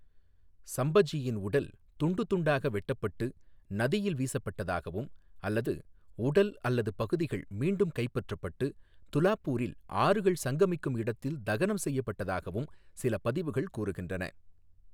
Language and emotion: Tamil, neutral